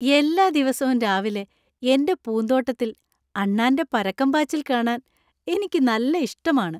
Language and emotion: Malayalam, happy